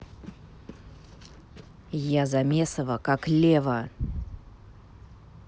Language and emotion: Russian, angry